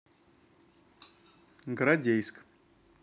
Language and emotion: Russian, neutral